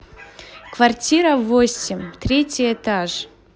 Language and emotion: Russian, positive